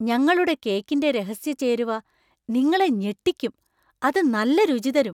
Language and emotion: Malayalam, surprised